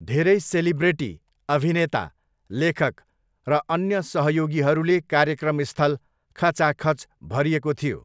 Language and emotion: Nepali, neutral